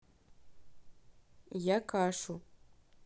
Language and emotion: Russian, neutral